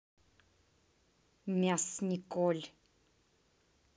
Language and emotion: Russian, angry